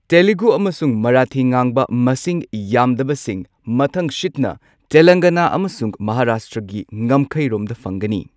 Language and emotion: Manipuri, neutral